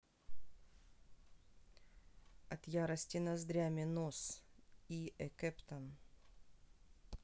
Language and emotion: Russian, neutral